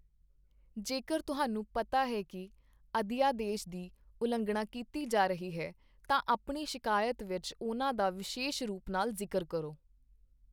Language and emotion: Punjabi, neutral